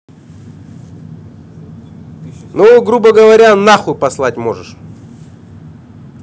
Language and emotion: Russian, angry